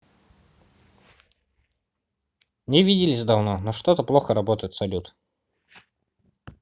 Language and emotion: Russian, neutral